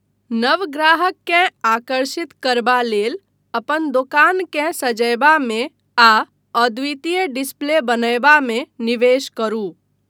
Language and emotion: Maithili, neutral